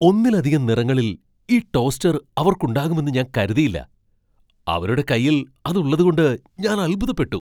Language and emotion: Malayalam, surprised